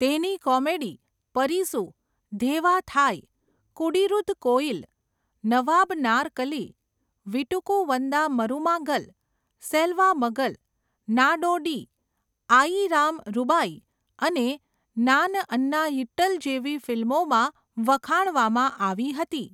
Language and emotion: Gujarati, neutral